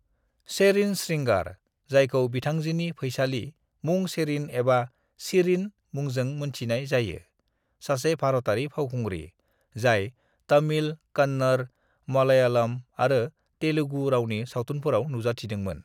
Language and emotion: Bodo, neutral